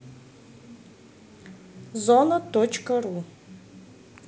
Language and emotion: Russian, neutral